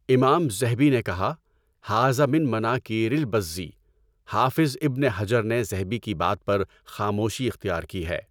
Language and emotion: Urdu, neutral